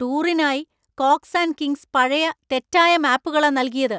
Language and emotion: Malayalam, angry